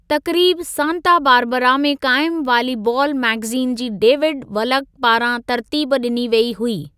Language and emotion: Sindhi, neutral